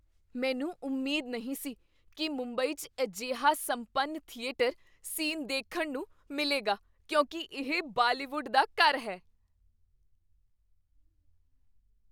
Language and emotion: Punjabi, surprised